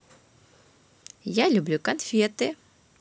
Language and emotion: Russian, positive